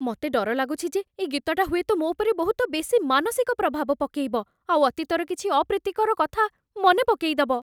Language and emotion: Odia, fearful